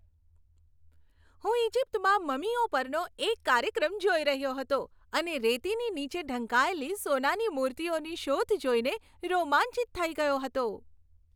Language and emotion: Gujarati, happy